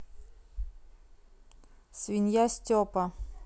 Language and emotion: Russian, neutral